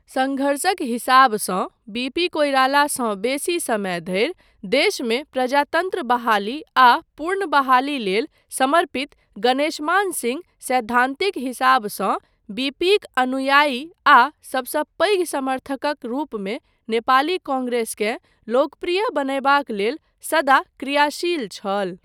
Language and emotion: Maithili, neutral